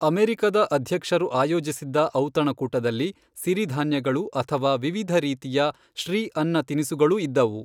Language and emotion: Kannada, neutral